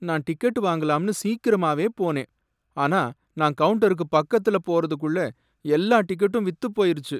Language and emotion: Tamil, sad